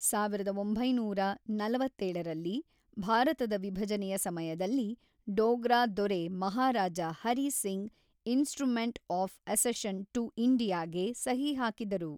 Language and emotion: Kannada, neutral